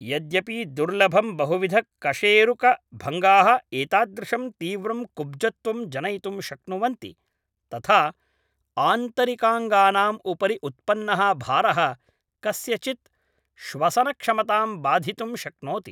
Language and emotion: Sanskrit, neutral